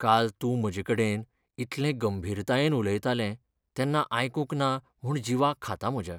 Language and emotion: Goan Konkani, sad